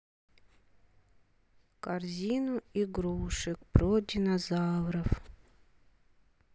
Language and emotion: Russian, sad